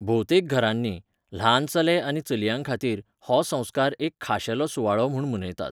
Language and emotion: Goan Konkani, neutral